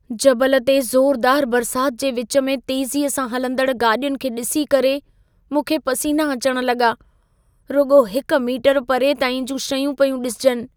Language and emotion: Sindhi, fearful